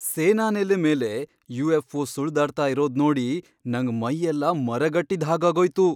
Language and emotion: Kannada, surprised